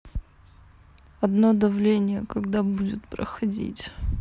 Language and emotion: Russian, sad